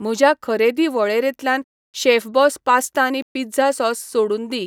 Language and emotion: Goan Konkani, neutral